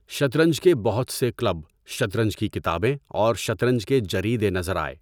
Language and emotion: Urdu, neutral